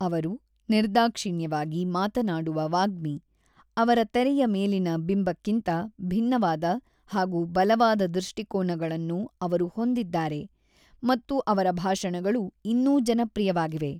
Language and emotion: Kannada, neutral